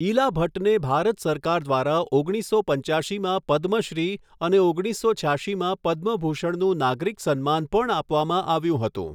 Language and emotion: Gujarati, neutral